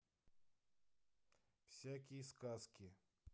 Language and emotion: Russian, neutral